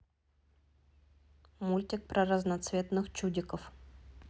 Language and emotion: Russian, neutral